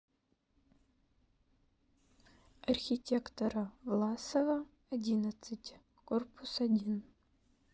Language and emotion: Russian, neutral